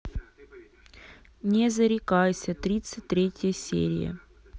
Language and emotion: Russian, neutral